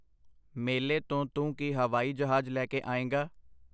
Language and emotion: Punjabi, neutral